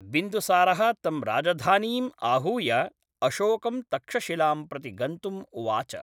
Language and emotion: Sanskrit, neutral